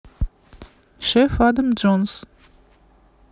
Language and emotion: Russian, neutral